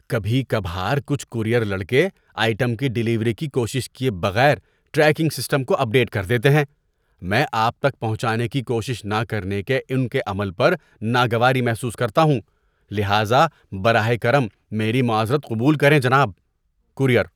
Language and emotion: Urdu, disgusted